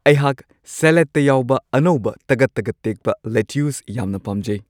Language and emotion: Manipuri, happy